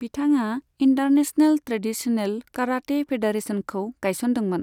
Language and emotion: Bodo, neutral